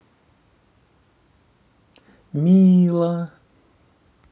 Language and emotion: Russian, neutral